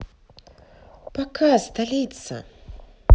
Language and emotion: Russian, neutral